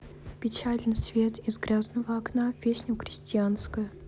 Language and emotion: Russian, sad